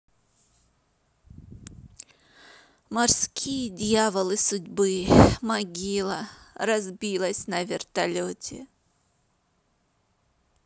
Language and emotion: Russian, sad